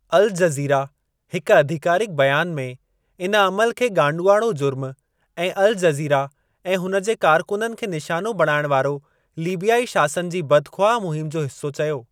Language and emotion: Sindhi, neutral